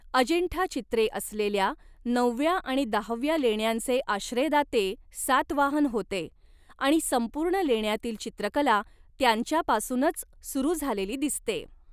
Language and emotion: Marathi, neutral